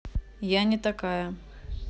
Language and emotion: Russian, neutral